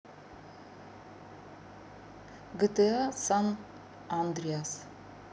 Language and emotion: Russian, neutral